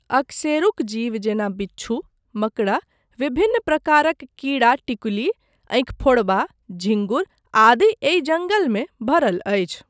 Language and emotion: Maithili, neutral